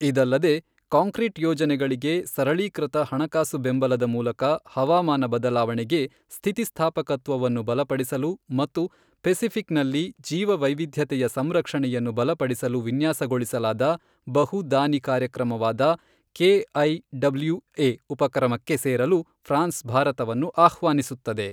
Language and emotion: Kannada, neutral